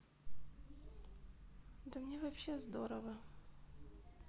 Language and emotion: Russian, sad